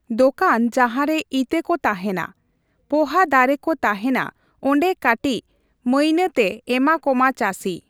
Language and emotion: Santali, neutral